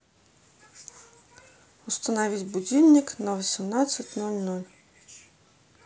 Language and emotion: Russian, neutral